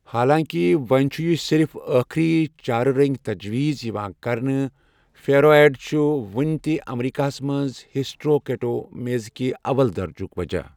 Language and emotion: Kashmiri, neutral